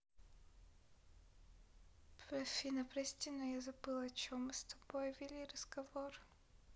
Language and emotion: Russian, sad